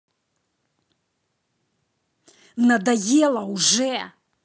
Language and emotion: Russian, angry